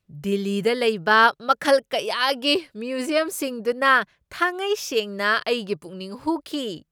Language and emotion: Manipuri, surprised